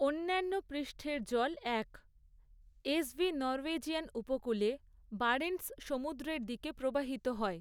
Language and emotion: Bengali, neutral